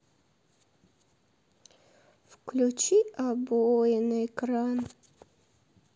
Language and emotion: Russian, sad